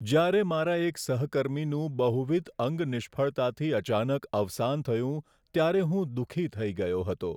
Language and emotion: Gujarati, sad